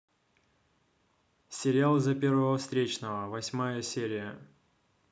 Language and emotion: Russian, neutral